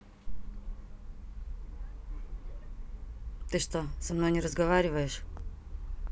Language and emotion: Russian, neutral